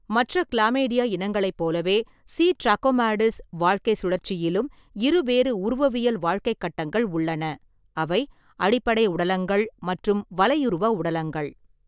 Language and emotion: Tamil, neutral